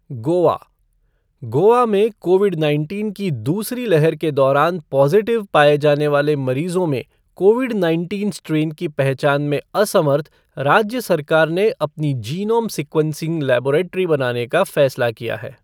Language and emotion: Hindi, neutral